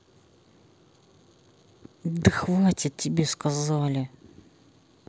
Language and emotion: Russian, angry